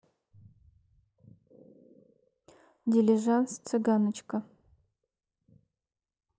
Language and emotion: Russian, neutral